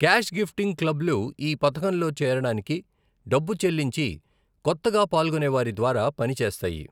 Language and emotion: Telugu, neutral